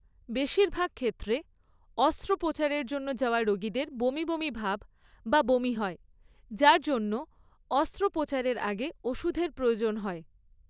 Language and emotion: Bengali, neutral